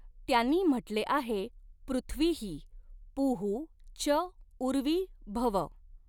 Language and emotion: Marathi, neutral